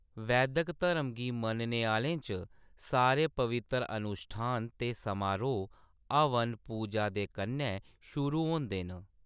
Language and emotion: Dogri, neutral